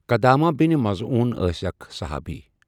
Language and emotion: Kashmiri, neutral